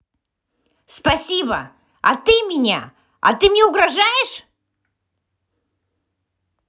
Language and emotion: Russian, angry